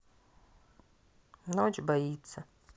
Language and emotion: Russian, neutral